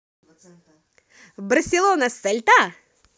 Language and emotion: Russian, positive